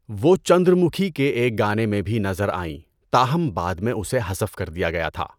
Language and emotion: Urdu, neutral